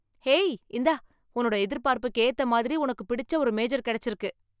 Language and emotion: Tamil, happy